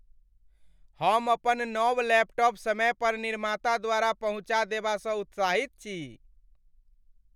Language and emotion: Maithili, happy